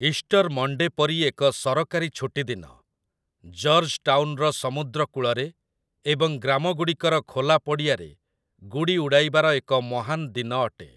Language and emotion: Odia, neutral